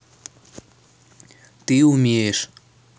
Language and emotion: Russian, neutral